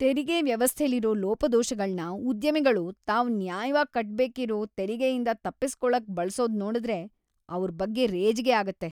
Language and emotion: Kannada, disgusted